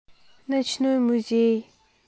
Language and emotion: Russian, neutral